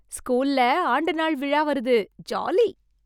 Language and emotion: Tamil, happy